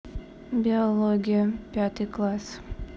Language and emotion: Russian, neutral